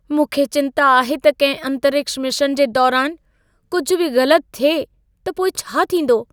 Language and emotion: Sindhi, fearful